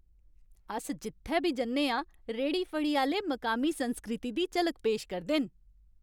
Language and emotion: Dogri, happy